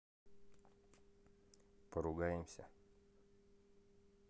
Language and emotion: Russian, neutral